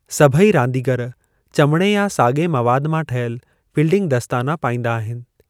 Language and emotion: Sindhi, neutral